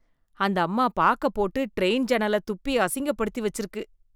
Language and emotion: Tamil, disgusted